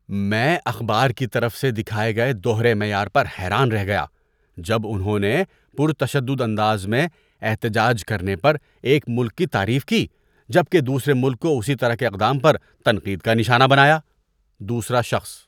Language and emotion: Urdu, disgusted